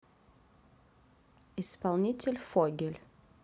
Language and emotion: Russian, neutral